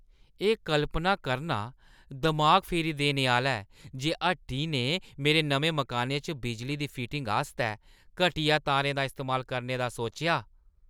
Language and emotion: Dogri, disgusted